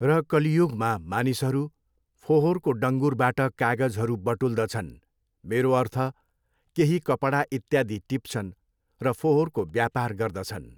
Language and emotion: Nepali, neutral